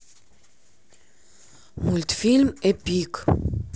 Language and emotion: Russian, neutral